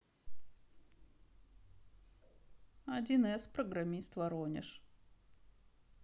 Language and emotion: Russian, neutral